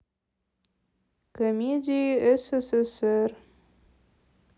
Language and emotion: Russian, sad